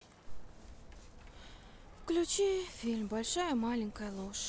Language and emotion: Russian, sad